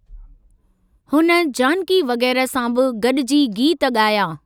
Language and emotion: Sindhi, neutral